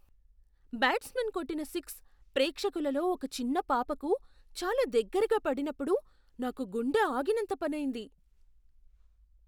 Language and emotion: Telugu, surprised